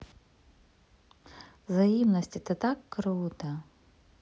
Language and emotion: Russian, positive